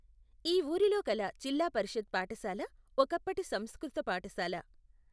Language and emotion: Telugu, neutral